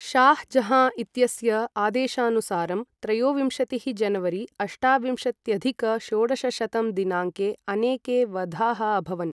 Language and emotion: Sanskrit, neutral